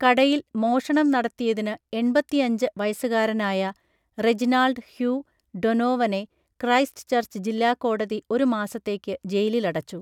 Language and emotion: Malayalam, neutral